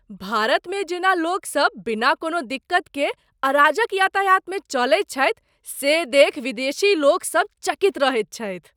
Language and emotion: Maithili, surprised